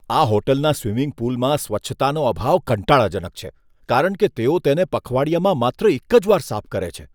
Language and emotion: Gujarati, disgusted